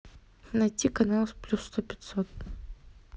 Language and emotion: Russian, neutral